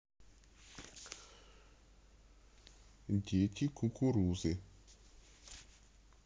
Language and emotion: Russian, neutral